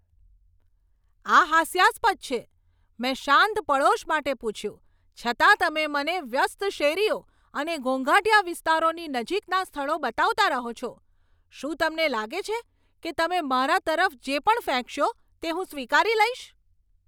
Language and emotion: Gujarati, angry